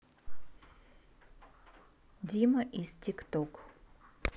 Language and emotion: Russian, neutral